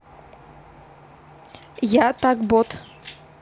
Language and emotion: Russian, neutral